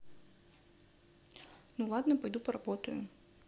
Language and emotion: Russian, neutral